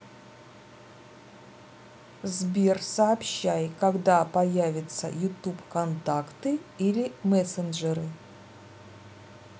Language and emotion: Russian, neutral